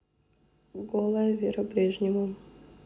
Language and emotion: Russian, neutral